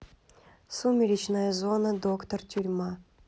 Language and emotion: Russian, neutral